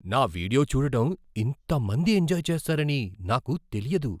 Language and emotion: Telugu, surprised